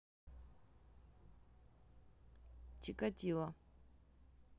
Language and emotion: Russian, neutral